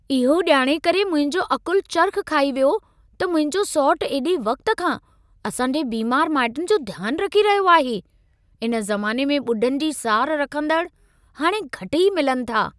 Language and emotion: Sindhi, surprised